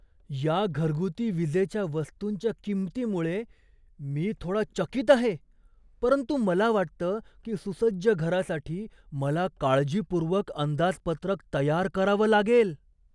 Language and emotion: Marathi, surprised